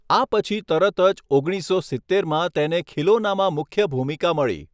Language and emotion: Gujarati, neutral